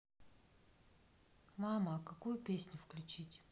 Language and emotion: Russian, neutral